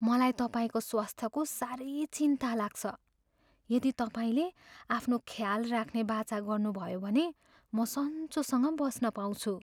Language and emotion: Nepali, fearful